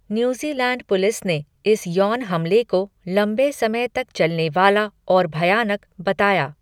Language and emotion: Hindi, neutral